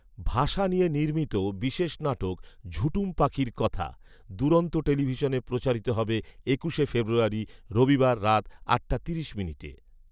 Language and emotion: Bengali, neutral